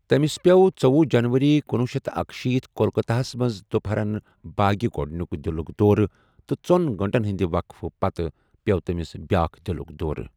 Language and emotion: Kashmiri, neutral